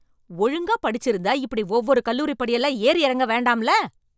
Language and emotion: Tamil, angry